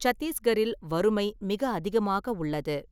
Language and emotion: Tamil, neutral